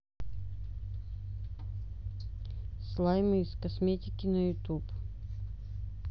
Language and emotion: Russian, neutral